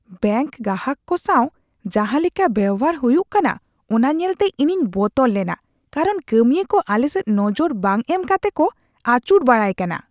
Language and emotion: Santali, disgusted